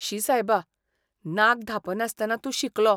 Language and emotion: Goan Konkani, disgusted